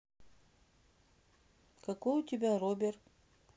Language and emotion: Russian, neutral